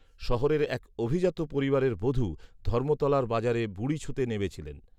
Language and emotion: Bengali, neutral